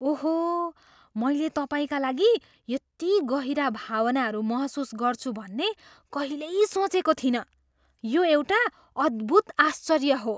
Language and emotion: Nepali, surprised